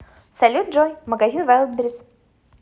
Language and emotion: Russian, positive